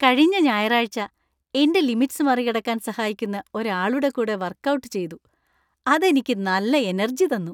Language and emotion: Malayalam, happy